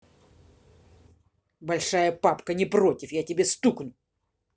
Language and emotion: Russian, angry